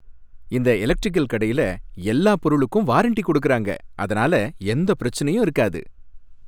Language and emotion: Tamil, happy